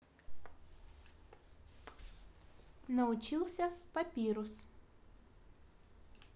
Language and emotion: Russian, neutral